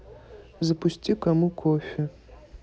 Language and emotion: Russian, neutral